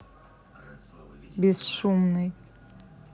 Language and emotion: Russian, neutral